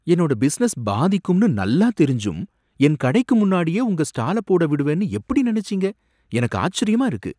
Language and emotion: Tamil, surprised